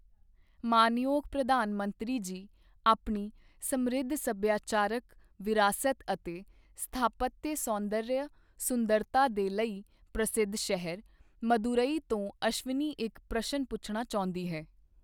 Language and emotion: Punjabi, neutral